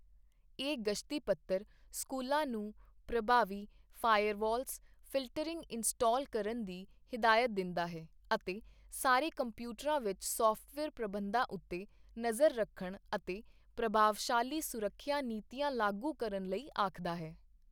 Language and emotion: Punjabi, neutral